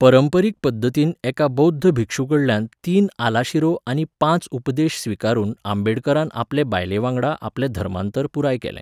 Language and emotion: Goan Konkani, neutral